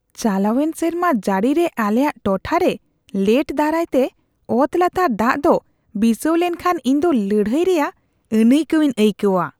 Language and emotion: Santali, disgusted